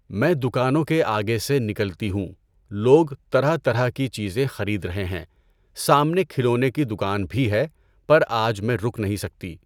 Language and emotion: Urdu, neutral